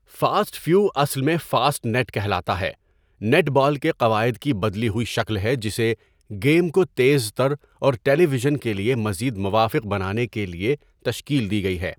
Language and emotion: Urdu, neutral